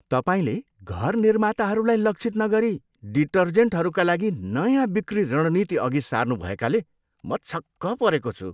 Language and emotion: Nepali, disgusted